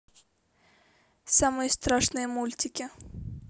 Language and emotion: Russian, neutral